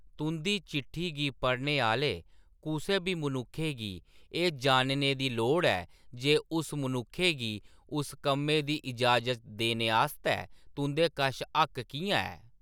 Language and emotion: Dogri, neutral